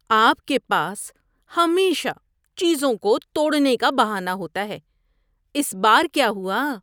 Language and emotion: Urdu, disgusted